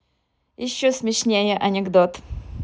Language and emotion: Russian, positive